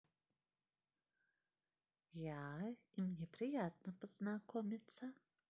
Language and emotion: Russian, positive